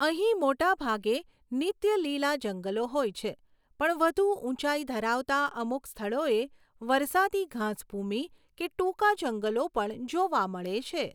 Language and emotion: Gujarati, neutral